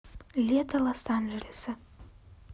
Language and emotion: Russian, neutral